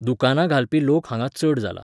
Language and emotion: Goan Konkani, neutral